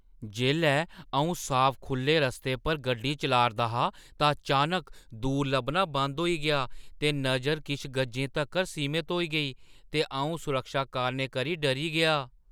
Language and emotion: Dogri, surprised